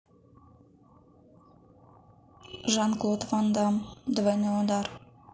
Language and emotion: Russian, neutral